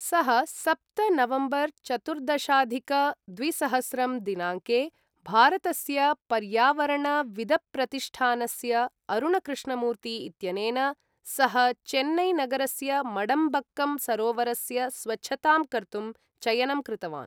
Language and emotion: Sanskrit, neutral